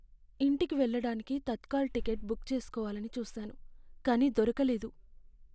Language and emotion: Telugu, sad